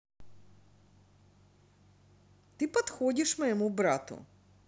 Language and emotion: Russian, positive